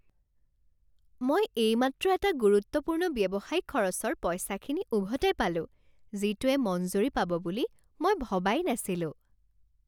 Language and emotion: Assamese, happy